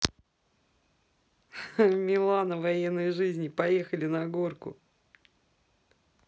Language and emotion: Russian, positive